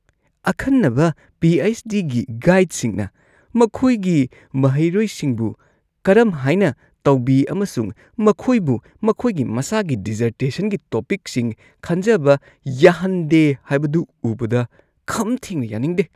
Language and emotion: Manipuri, disgusted